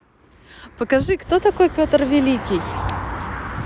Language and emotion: Russian, positive